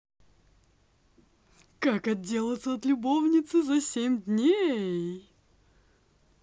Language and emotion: Russian, positive